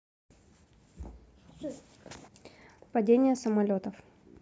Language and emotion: Russian, neutral